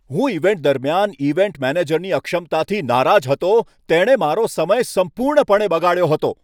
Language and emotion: Gujarati, angry